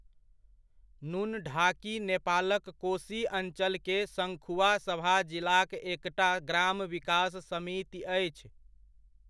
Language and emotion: Maithili, neutral